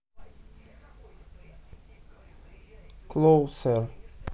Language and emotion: Russian, neutral